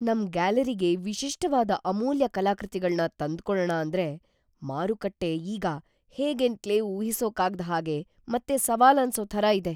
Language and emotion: Kannada, fearful